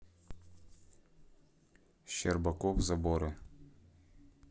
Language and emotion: Russian, neutral